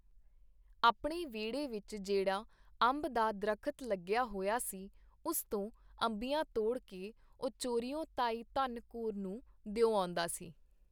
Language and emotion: Punjabi, neutral